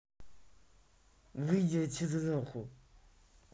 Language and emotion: Russian, angry